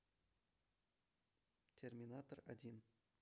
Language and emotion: Russian, neutral